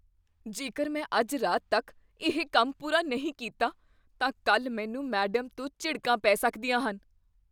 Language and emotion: Punjabi, fearful